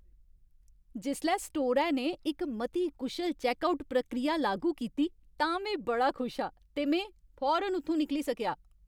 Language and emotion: Dogri, happy